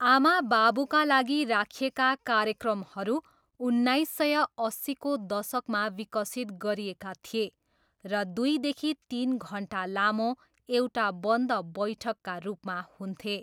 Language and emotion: Nepali, neutral